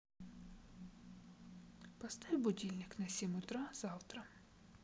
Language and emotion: Russian, neutral